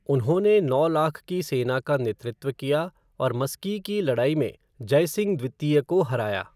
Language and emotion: Hindi, neutral